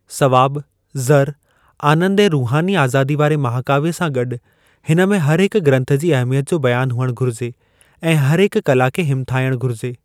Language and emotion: Sindhi, neutral